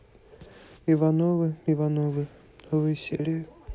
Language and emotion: Russian, neutral